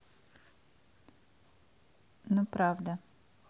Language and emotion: Russian, neutral